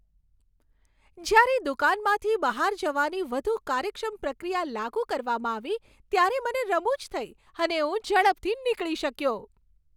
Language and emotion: Gujarati, happy